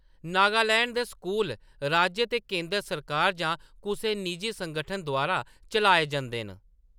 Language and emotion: Dogri, neutral